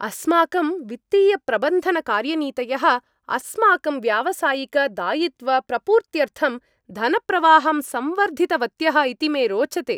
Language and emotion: Sanskrit, happy